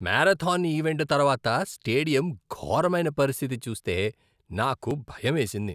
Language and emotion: Telugu, disgusted